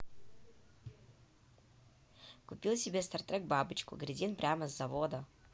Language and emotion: Russian, positive